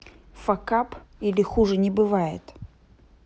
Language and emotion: Russian, neutral